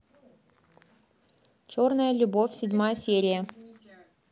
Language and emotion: Russian, neutral